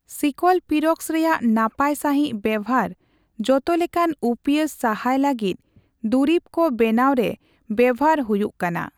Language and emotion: Santali, neutral